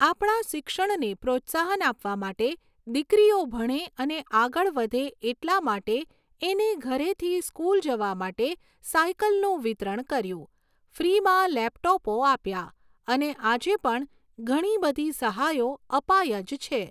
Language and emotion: Gujarati, neutral